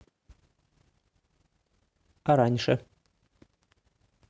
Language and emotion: Russian, neutral